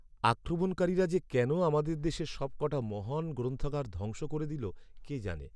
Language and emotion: Bengali, sad